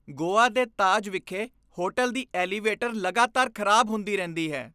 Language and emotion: Punjabi, disgusted